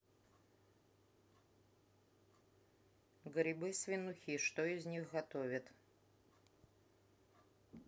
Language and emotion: Russian, neutral